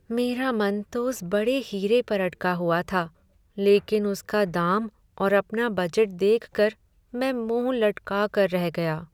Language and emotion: Hindi, sad